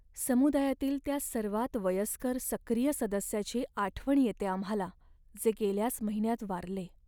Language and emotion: Marathi, sad